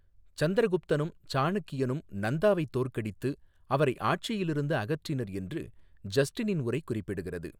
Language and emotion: Tamil, neutral